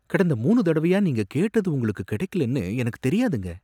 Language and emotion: Tamil, surprised